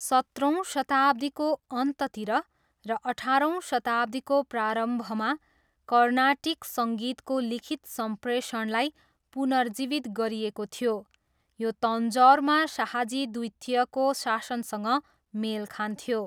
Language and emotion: Nepali, neutral